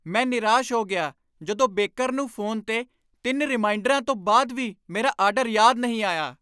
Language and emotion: Punjabi, angry